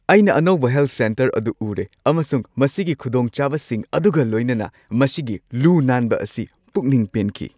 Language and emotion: Manipuri, happy